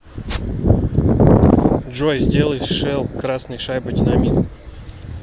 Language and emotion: Russian, neutral